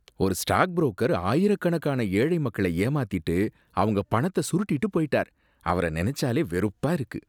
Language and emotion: Tamil, disgusted